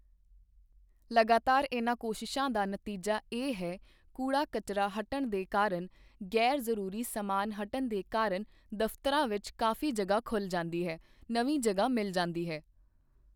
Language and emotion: Punjabi, neutral